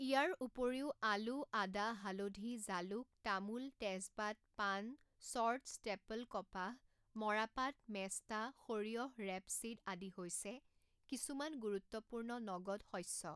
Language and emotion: Assamese, neutral